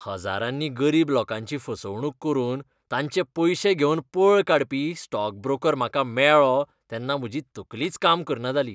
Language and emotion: Goan Konkani, disgusted